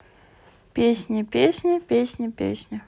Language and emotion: Russian, neutral